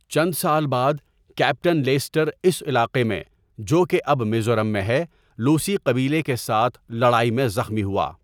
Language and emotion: Urdu, neutral